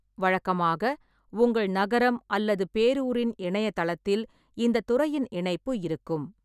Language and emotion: Tamil, neutral